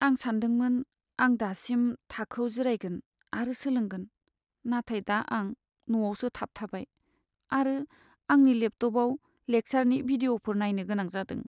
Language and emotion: Bodo, sad